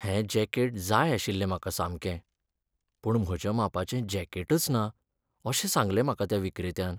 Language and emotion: Goan Konkani, sad